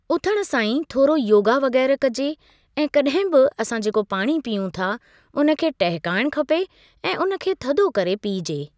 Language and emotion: Sindhi, neutral